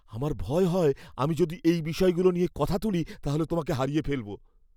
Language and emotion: Bengali, fearful